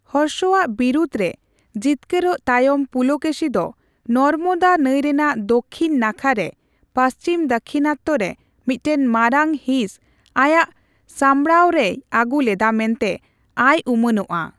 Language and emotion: Santali, neutral